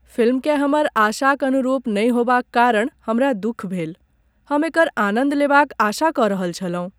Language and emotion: Maithili, sad